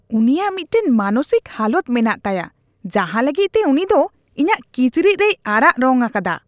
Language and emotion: Santali, disgusted